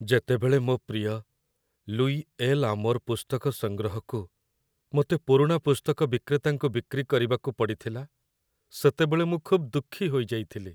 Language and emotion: Odia, sad